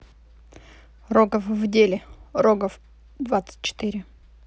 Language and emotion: Russian, neutral